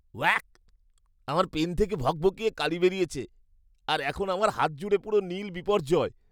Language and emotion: Bengali, disgusted